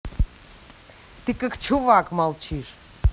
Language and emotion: Russian, angry